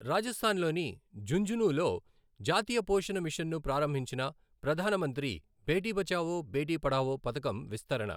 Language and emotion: Telugu, neutral